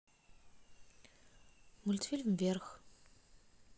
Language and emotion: Russian, neutral